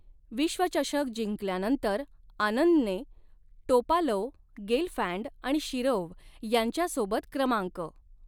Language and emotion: Marathi, neutral